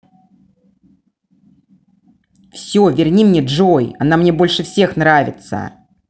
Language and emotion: Russian, angry